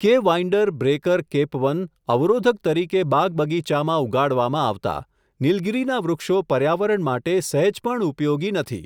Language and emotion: Gujarati, neutral